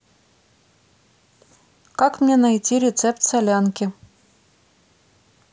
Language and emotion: Russian, neutral